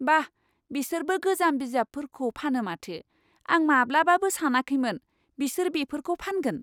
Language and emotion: Bodo, surprised